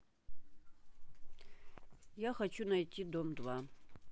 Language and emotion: Russian, neutral